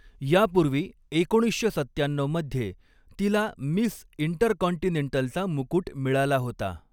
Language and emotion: Marathi, neutral